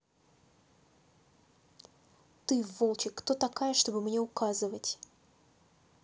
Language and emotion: Russian, angry